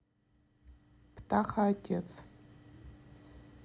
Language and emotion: Russian, neutral